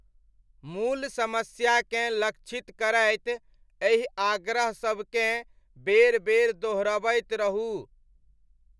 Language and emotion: Maithili, neutral